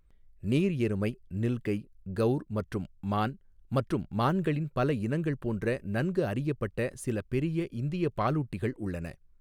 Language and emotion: Tamil, neutral